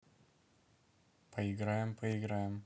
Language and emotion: Russian, neutral